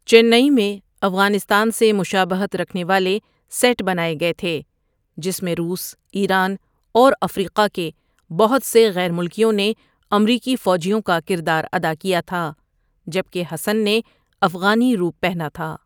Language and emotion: Urdu, neutral